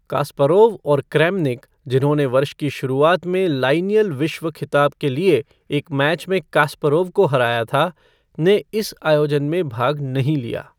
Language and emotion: Hindi, neutral